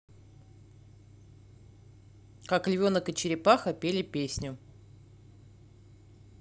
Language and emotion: Russian, neutral